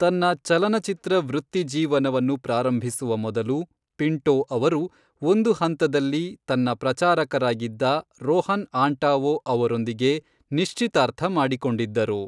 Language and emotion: Kannada, neutral